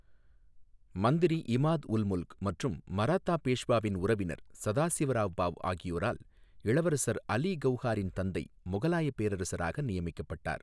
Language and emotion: Tamil, neutral